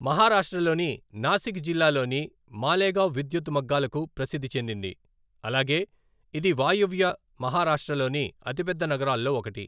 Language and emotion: Telugu, neutral